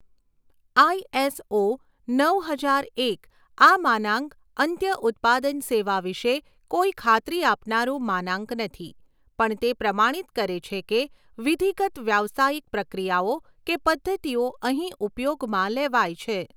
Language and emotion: Gujarati, neutral